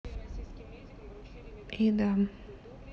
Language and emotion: Russian, sad